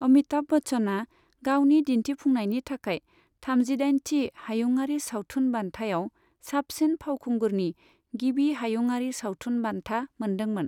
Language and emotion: Bodo, neutral